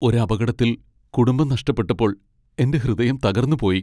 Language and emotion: Malayalam, sad